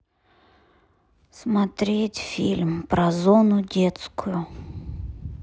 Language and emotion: Russian, sad